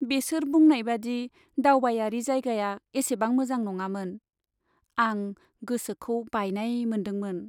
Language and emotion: Bodo, sad